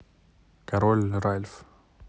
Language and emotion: Russian, neutral